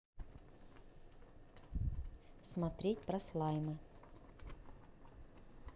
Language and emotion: Russian, neutral